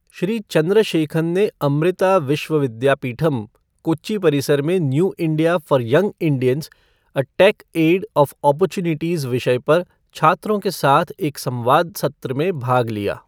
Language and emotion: Hindi, neutral